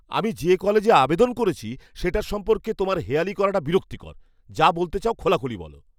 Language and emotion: Bengali, angry